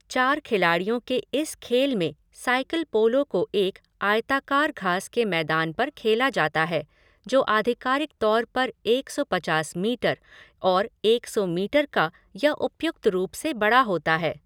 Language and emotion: Hindi, neutral